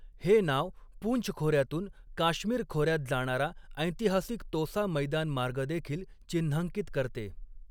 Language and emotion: Marathi, neutral